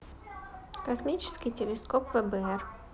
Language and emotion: Russian, neutral